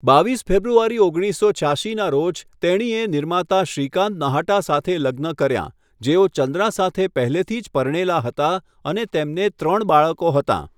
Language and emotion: Gujarati, neutral